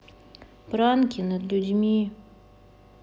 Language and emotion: Russian, sad